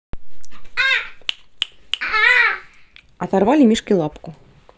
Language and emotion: Russian, neutral